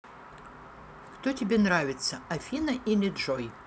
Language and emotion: Russian, neutral